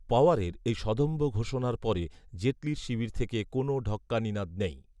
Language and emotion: Bengali, neutral